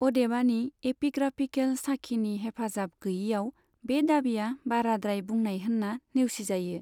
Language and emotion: Bodo, neutral